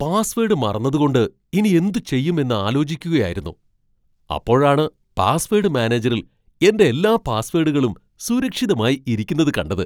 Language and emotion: Malayalam, surprised